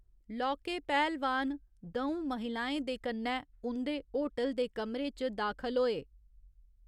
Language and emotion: Dogri, neutral